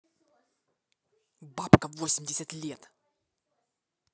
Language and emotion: Russian, angry